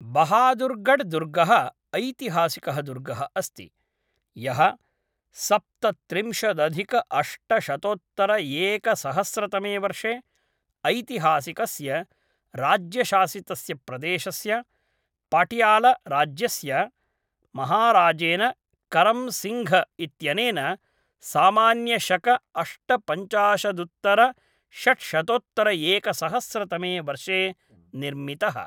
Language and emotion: Sanskrit, neutral